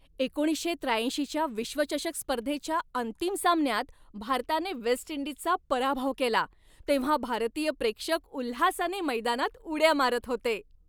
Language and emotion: Marathi, happy